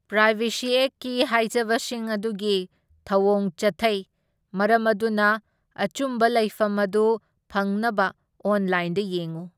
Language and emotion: Manipuri, neutral